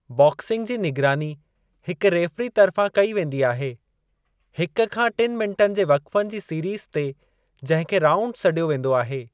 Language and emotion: Sindhi, neutral